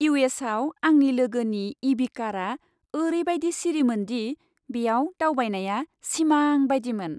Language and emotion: Bodo, happy